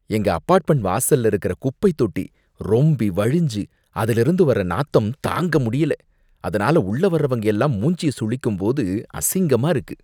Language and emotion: Tamil, disgusted